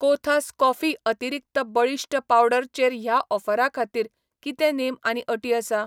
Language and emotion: Goan Konkani, neutral